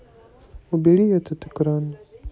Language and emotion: Russian, sad